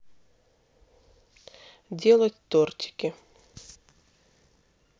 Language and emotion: Russian, neutral